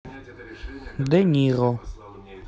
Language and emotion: Russian, neutral